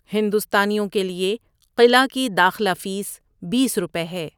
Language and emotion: Urdu, neutral